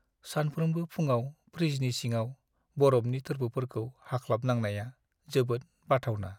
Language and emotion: Bodo, sad